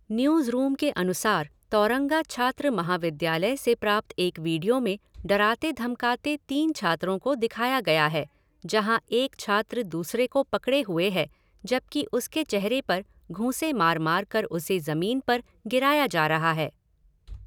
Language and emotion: Hindi, neutral